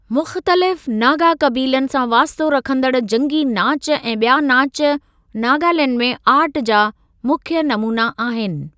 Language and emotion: Sindhi, neutral